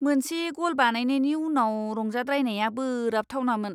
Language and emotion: Bodo, disgusted